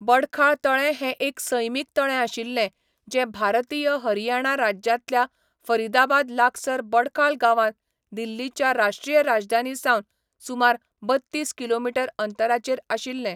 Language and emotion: Goan Konkani, neutral